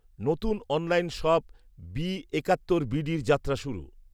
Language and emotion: Bengali, neutral